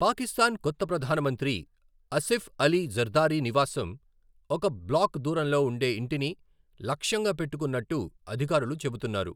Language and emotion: Telugu, neutral